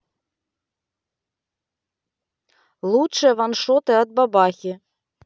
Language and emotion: Russian, neutral